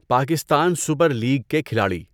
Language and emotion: Urdu, neutral